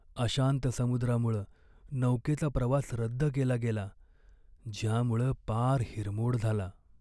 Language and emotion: Marathi, sad